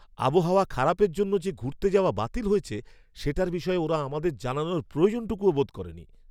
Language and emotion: Bengali, angry